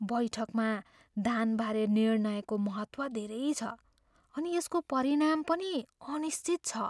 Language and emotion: Nepali, fearful